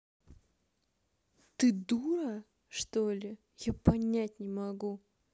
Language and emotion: Russian, angry